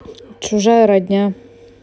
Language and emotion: Russian, neutral